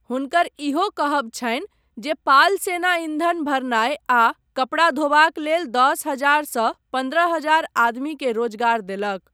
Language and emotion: Maithili, neutral